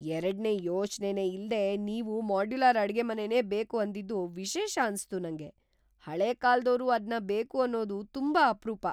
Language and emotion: Kannada, surprised